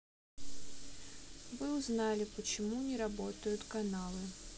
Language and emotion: Russian, sad